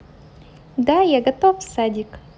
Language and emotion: Russian, positive